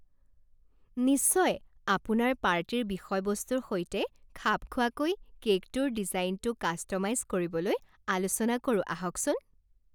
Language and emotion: Assamese, happy